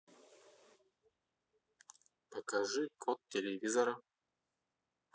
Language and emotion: Russian, neutral